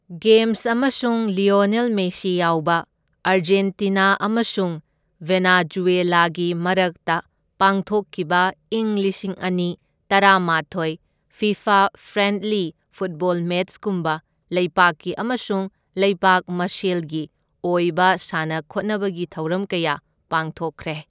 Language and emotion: Manipuri, neutral